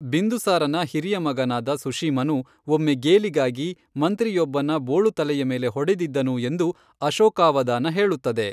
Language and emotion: Kannada, neutral